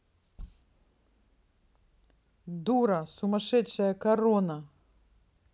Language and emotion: Russian, angry